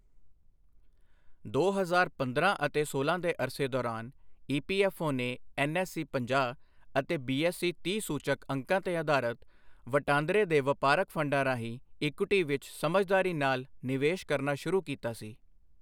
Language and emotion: Punjabi, neutral